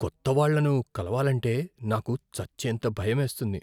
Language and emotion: Telugu, fearful